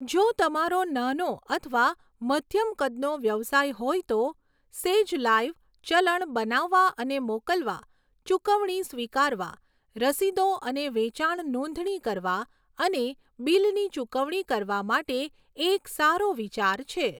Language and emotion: Gujarati, neutral